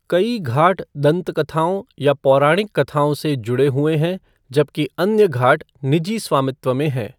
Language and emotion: Hindi, neutral